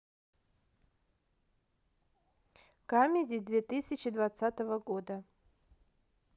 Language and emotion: Russian, neutral